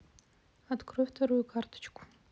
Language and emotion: Russian, neutral